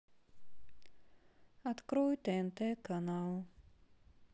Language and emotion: Russian, sad